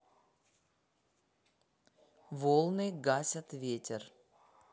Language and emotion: Russian, neutral